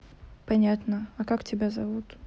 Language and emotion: Russian, neutral